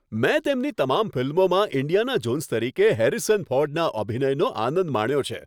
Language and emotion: Gujarati, happy